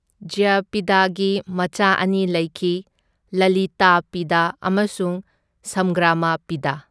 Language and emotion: Manipuri, neutral